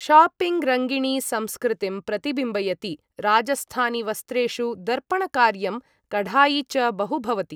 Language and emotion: Sanskrit, neutral